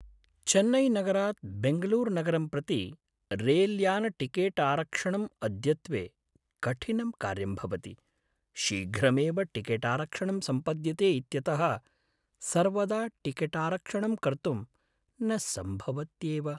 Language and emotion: Sanskrit, sad